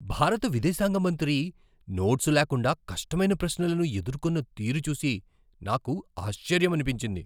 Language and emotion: Telugu, surprised